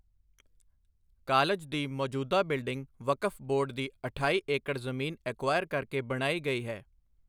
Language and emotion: Punjabi, neutral